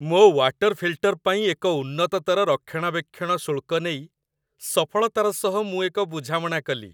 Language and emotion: Odia, happy